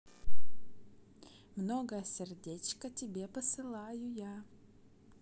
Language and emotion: Russian, positive